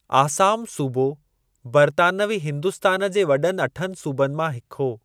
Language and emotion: Sindhi, neutral